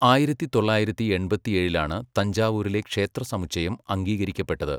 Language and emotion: Malayalam, neutral